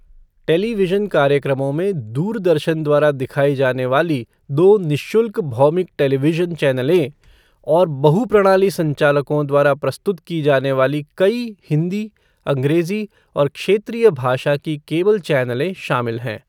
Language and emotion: Hindi, neutral